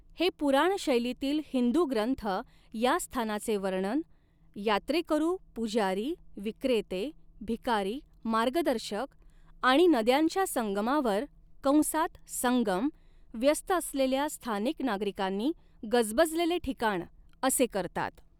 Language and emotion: Marathi, neutral